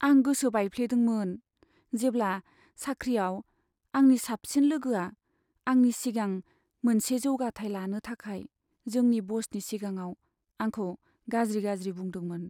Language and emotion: Bodo, sad